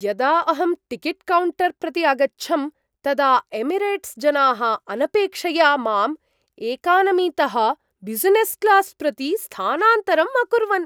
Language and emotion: Sanskrit, surprised